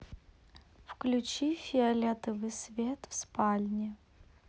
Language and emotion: Russian, neutral